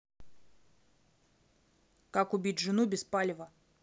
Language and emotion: Russian, neutral